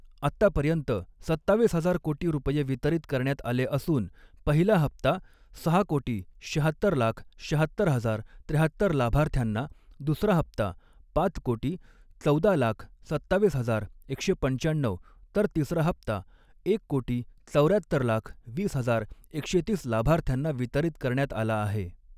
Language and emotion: Marathi, neutral